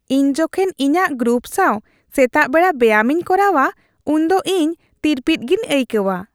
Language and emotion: Santali, happy